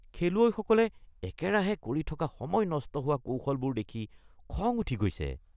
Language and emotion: Assamese, disgusted